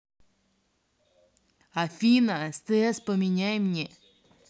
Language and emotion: Russian, angry